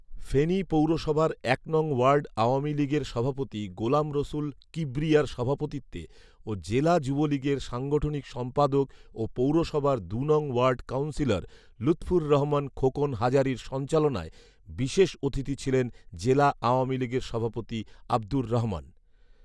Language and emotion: Bengali, neutral